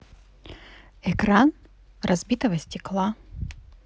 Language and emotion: Russian, positive